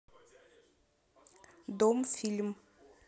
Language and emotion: Russian, neutral